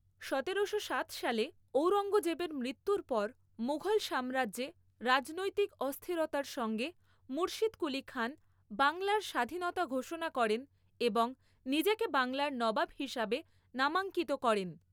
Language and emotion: Bengali, neutral